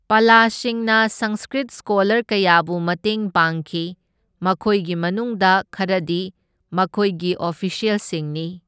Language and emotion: Manipuri, neutral